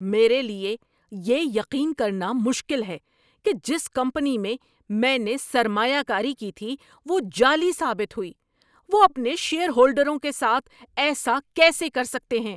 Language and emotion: Urdu, angry